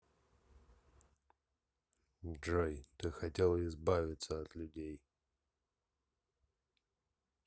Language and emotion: Russian, neutral